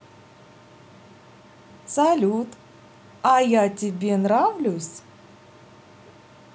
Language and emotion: Russian, neutral